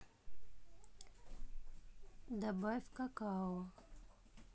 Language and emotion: Russian, neutral